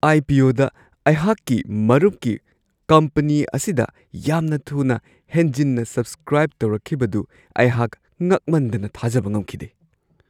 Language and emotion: Manipuri, surprised